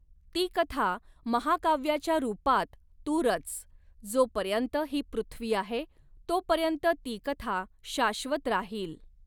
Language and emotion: Marathi, neutral